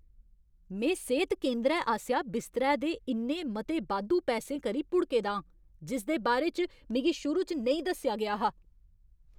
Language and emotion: Dogri, angry